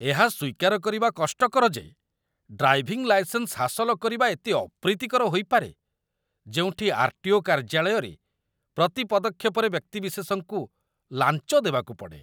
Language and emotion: Odia, disgusted